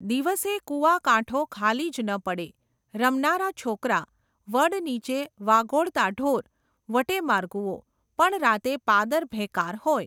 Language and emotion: Gujarati, neutral